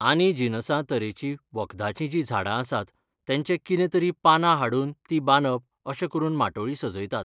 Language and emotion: Goan Konkani, neutral